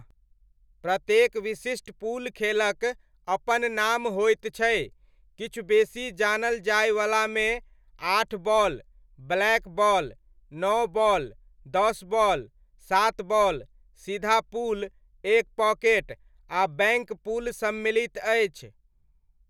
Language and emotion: Maithili, neutral